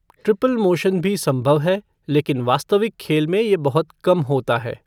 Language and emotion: Hindi, neutral